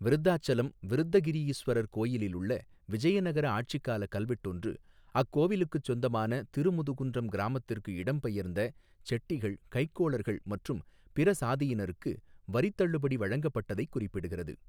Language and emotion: Tamil, neutral